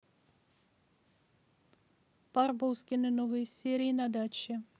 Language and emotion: Russian, neutral